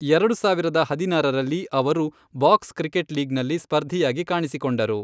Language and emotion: Kannada, neutral